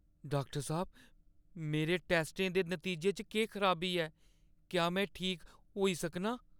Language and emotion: Dogri, fearful